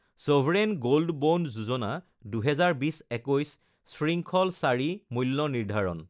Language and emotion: Assamese, neutral